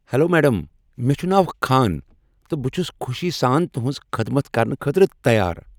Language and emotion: Kashmiri, happy